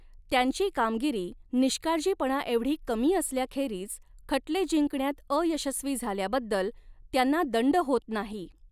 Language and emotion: Marathi, neutral